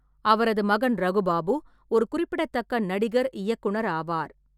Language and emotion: Tamil, neutral